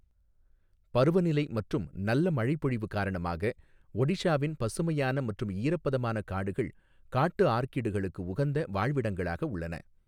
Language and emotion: Tamil, neutral